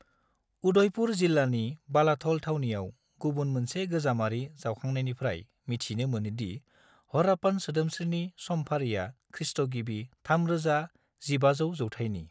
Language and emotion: Bodo, neutral